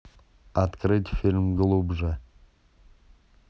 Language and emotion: Russian, neutral